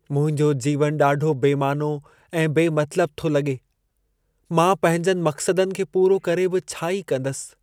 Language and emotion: Sindhi, sad